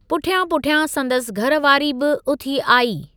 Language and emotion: Sindhi, neutral